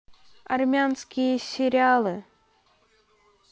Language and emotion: Russian, neutral